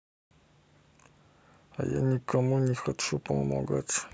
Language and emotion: Russian, sad